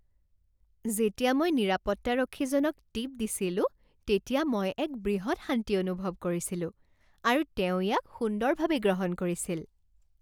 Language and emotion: Assamese, happy